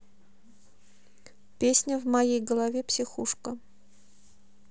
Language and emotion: Russian, neutral